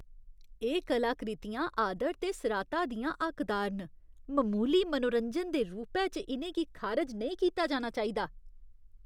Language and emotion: Dogri, disgusted